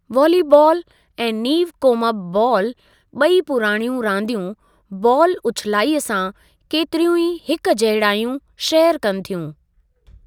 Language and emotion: Sindhi, neutral